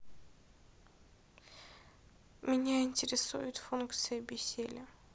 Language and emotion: Russian, sad